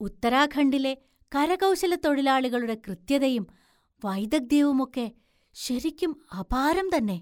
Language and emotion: Malayalam, surprised